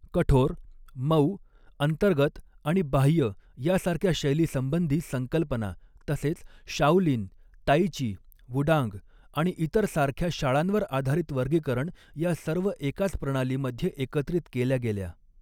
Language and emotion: Marathi, neutral